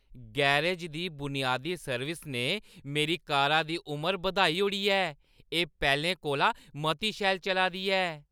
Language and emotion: Dogri, happy